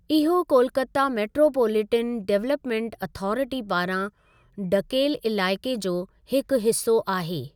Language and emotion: Sindhi, neutral